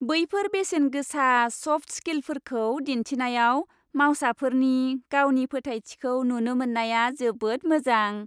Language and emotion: Bodo, happy